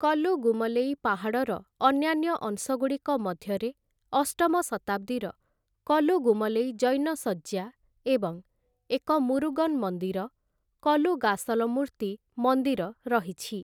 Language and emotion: Odia, neutral